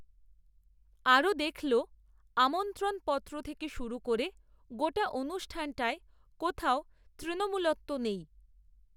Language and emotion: Bengali, neutral